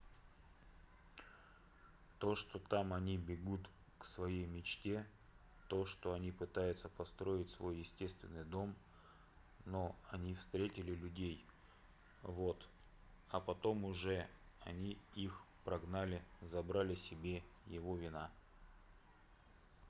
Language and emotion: Russian, neutral